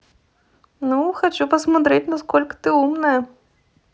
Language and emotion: Russian, neutral